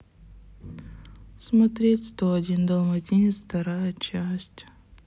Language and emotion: Russian, sad